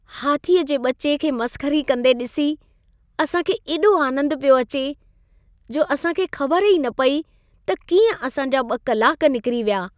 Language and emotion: Sindhi, happy